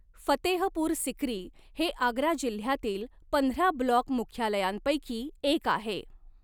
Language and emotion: Marathi, neutral